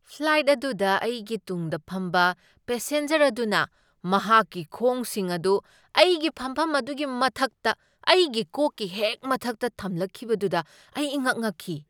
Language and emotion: Manipuri, surprised